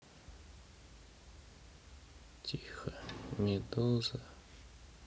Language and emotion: Russian, sad